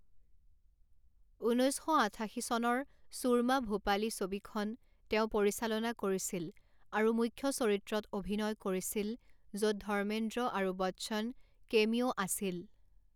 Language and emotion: Assamese, neutral